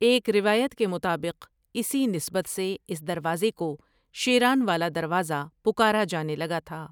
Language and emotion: Urdu, neutral